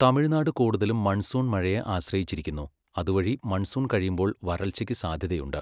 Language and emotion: Malayalam, neutral